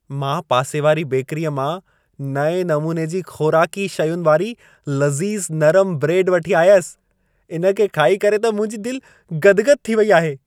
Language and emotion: Sindhi, happy